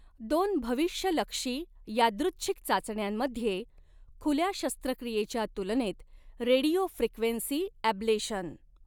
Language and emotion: Marathi, neutral